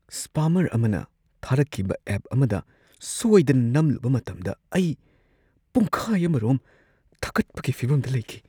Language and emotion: Manipuri, fearful